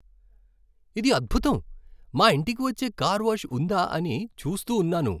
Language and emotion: Telugu, happy